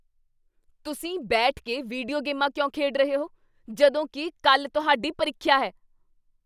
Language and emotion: Punjabi, angry